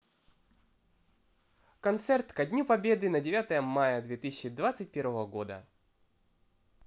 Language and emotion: Russian, positive